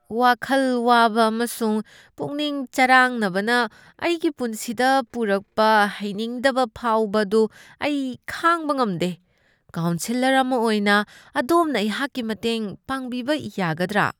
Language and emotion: Manipuri, disgusted